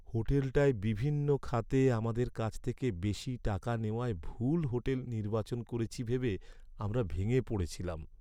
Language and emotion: Bengali, sad